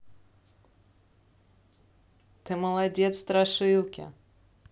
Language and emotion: Russian, neutral